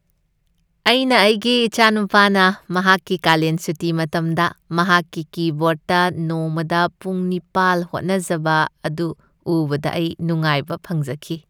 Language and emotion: Manipuri, happy